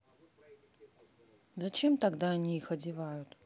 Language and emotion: Russian, sad